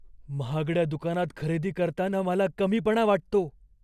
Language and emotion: Marathi, fearful